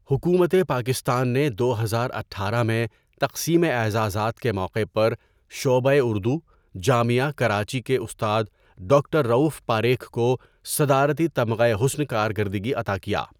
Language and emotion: Urdu, neutral